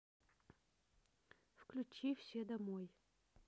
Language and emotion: Russian, neutral